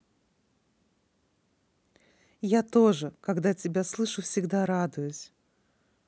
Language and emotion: Russian, positive